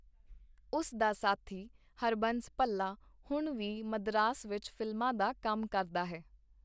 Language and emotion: Punjabi, neutral